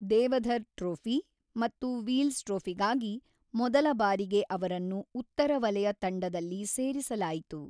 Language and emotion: Kannada, neutral